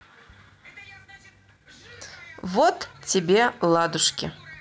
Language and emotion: Russian, neutral